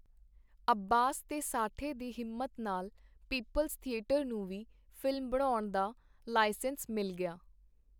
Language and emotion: Punjabi, neutral